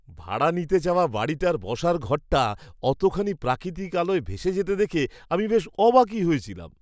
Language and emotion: Bengali, surprised